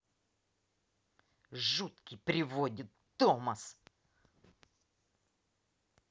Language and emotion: Russian, angry